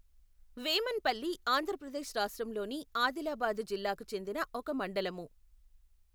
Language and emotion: Telugu, neutral